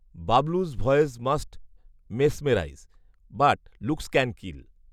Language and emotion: Bengali, neutral